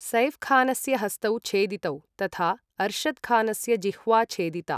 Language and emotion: Sanskrit, neutral